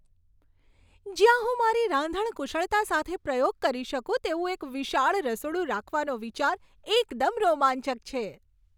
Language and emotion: Gujarati, happy